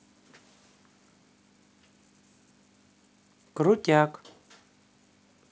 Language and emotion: Russian, neutral